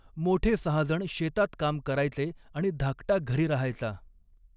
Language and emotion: Marathi, neutral